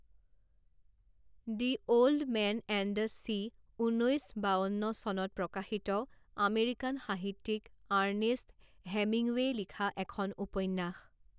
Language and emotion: Assamese, neutral